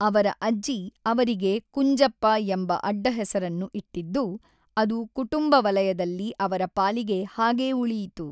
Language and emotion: Kannada, neutral